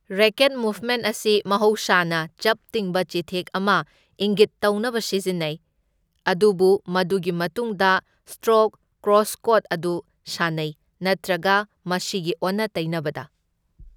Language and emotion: Manipuri, neutral